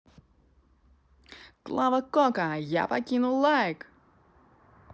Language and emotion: Russian, positive